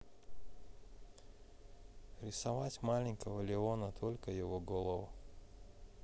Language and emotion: Russian, neutral